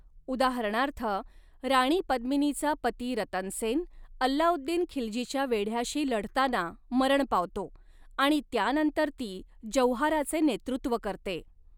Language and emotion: Marathi, neutral